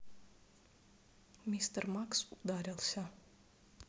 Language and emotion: Russian, neutral